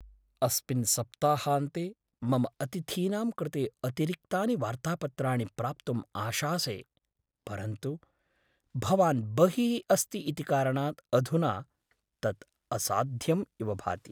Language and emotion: Sanskrit, sad